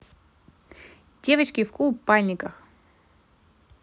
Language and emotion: Russian, positive